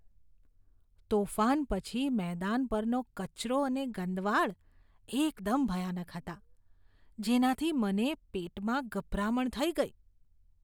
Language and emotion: Gujarati, disgusted